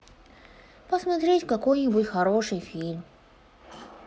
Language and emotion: Russian, sad